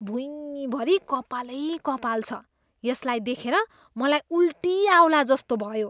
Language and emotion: Nepali, disgusted